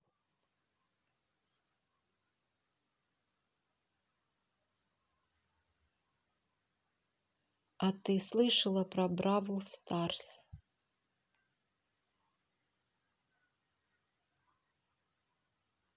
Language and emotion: Russian, neutral